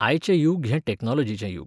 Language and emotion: Goan Konkani, neutral